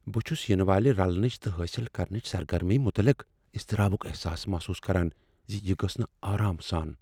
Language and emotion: Kashmiri, fearful